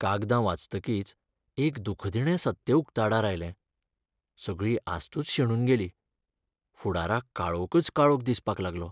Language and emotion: Goan Konkani, sad